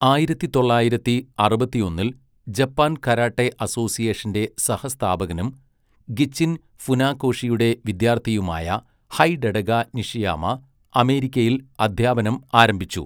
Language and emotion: Malayalam, neutral